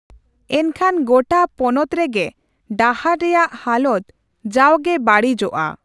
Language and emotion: Santali, neutral